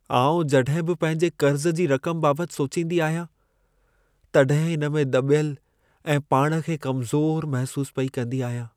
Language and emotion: Sindhi, sad